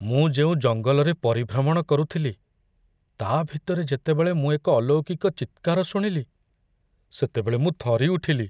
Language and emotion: Odia, fearful